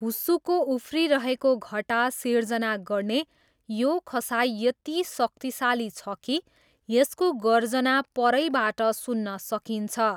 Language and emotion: Nepali, neutral